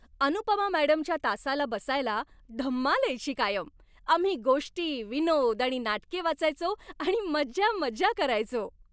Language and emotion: Marathi, happy